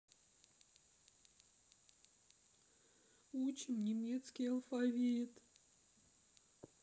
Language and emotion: Russian, sad